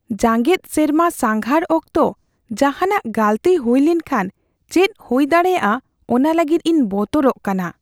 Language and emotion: Santali, fearful